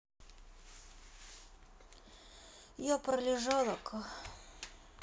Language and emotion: Russian, sad